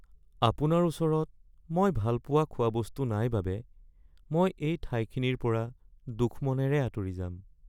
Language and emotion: Assamese, sad